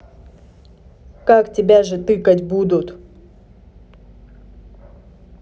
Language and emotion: Russian, neutral